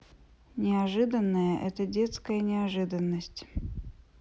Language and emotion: Russian, neutral